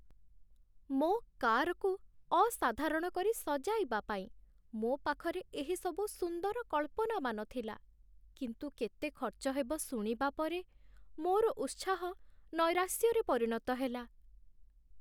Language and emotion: Odia, sad